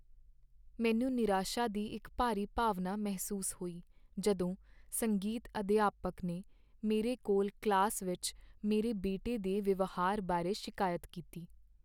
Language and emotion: Punjabi, sad